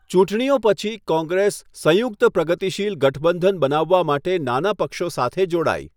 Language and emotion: Gujarati, neutral